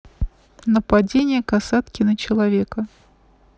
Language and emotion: Russian, neutral